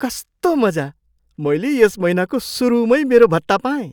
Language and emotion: Nepali, surprised